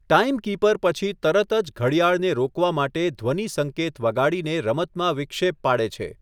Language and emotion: Gujarati, neutral